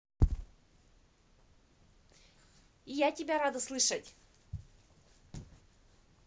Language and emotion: Russian, positive